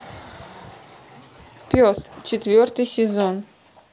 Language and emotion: Russian, neutral